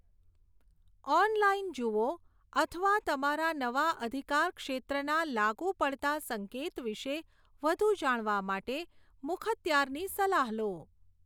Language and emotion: Gujarati, neutral